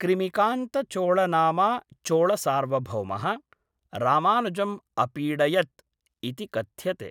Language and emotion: Sanskrit, neutral